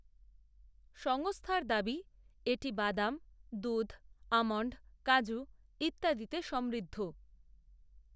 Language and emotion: Bengali, neutral